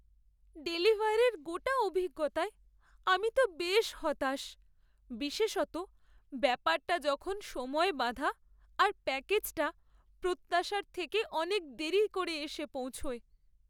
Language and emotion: Bengali, sad